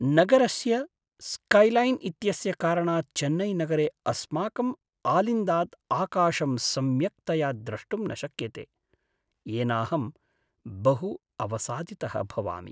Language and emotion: Sanskrit, sad